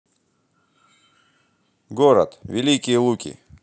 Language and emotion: Russian, positive